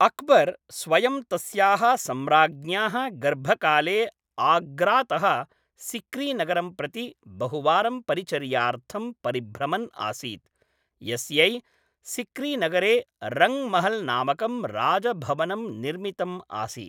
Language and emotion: Sanskrit, neutral